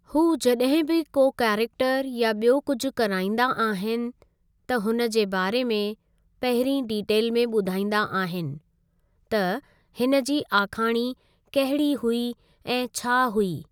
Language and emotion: Sindhi, neutral